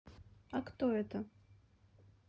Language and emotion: Russian, neutral